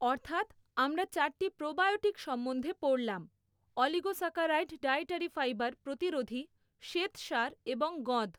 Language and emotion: Bengali, neutral